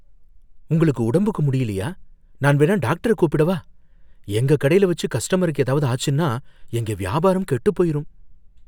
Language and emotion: Tamil, fearful